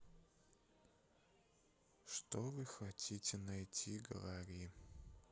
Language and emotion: Russian, sad